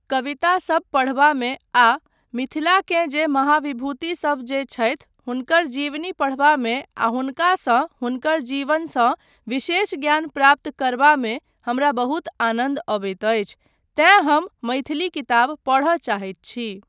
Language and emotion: Maithili, neutral